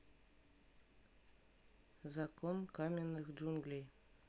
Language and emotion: Russian, neutral